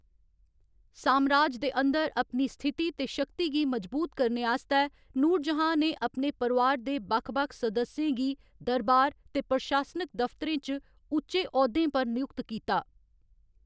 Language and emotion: Dogri, neutral